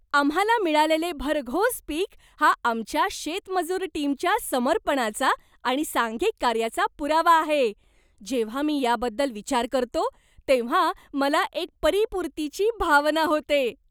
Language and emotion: Marathi, happy